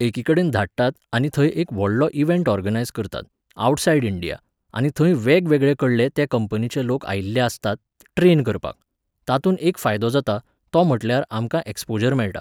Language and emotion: Goan Konkani, neutral